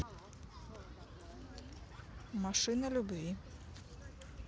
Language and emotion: Russian, neutral